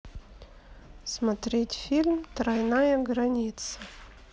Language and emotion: Russian, neutral